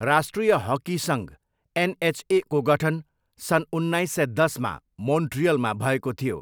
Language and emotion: Nepali, neutral